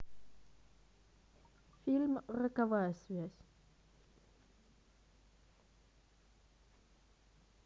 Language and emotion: Russian, neutral